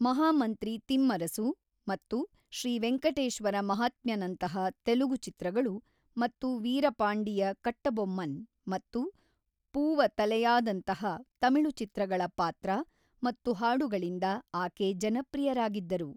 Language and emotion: Kannada, neutral